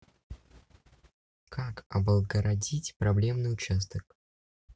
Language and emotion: Russian, neutral